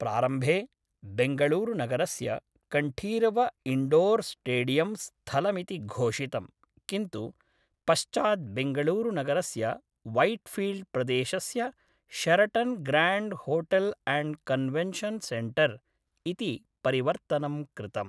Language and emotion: Sanskrit, neutral